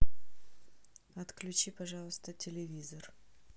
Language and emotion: Russian, neutral